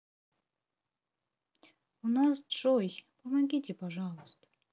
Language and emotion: Russian, sad